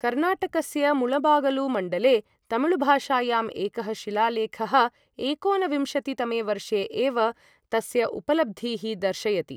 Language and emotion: Sanskrit, neutral